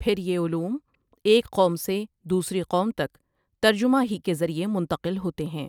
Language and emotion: Urdu, neutral